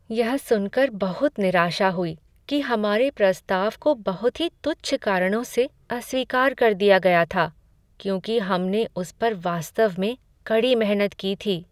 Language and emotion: Hindi, sad